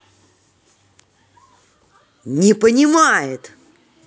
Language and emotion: Russian, angry